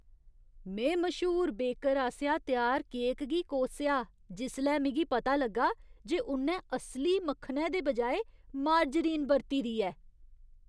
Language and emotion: Dogri, disgusted